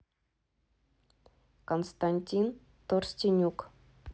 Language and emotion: Russian, neutral